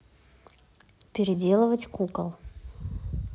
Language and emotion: Russian, neutral